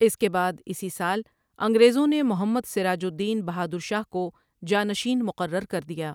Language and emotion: Urdu, neutral